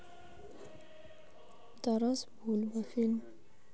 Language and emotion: Russian, neutral